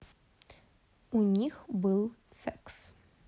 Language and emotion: Russian, neutral